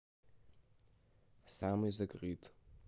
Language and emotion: Russian, neutral